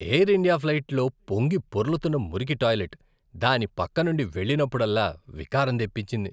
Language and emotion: Telugu, disgusted